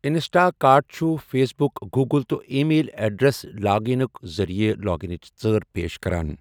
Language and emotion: Kashmiri, neutral